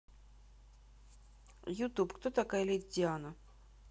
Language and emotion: Russian, neutral